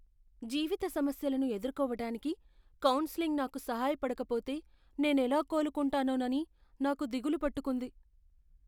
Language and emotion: Telugu, fearful